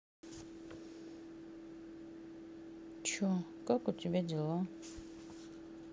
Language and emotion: Russian, neutral